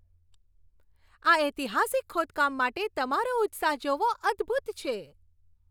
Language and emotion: Gujarati, happy